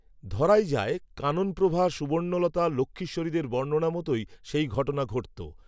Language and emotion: Bengali, neutral